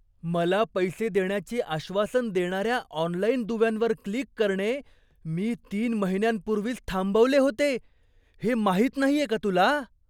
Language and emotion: Marathi, surprised